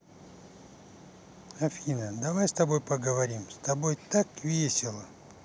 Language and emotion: Russian, positive